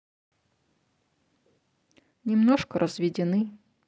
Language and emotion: Russian, sad